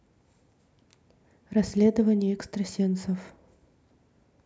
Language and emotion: Russian, neutral